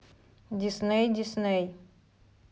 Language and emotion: Russian, neutral